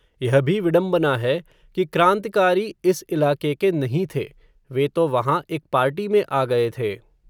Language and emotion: Hindi, neutral